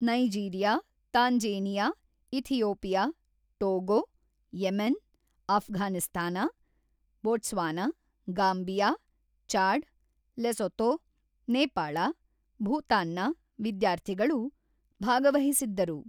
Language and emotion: Kannada, neutral